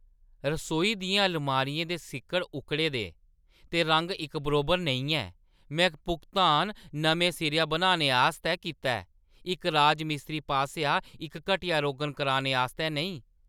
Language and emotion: Dogri, angry